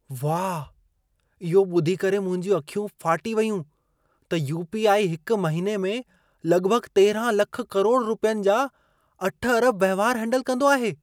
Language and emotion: Sindhi, surprised